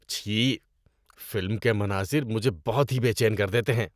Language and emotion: Urdu, disgusted